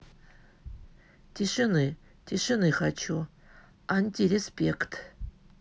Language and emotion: Russian, neutral